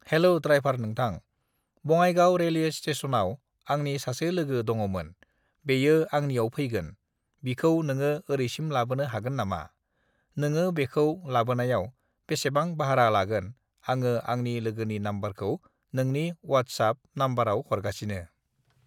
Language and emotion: Bodo, neutral